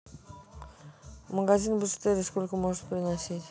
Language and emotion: Russian, neutral